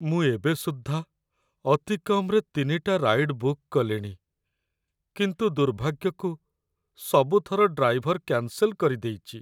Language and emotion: Odia, sad